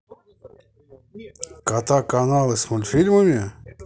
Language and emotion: Russian, neutral